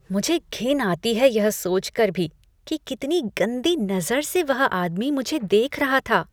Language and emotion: Hindi, disgusted